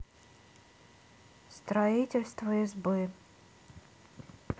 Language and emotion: Russian, neutral